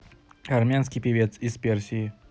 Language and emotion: Russian, neutral